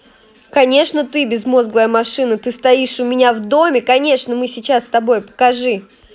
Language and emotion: Russian, angry